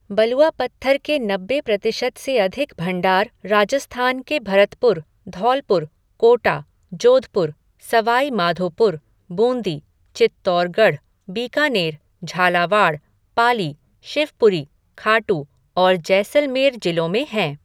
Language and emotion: Hindi, neutral